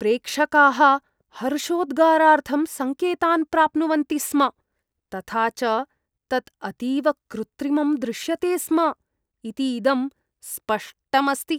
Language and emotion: Sanskrit, disgusted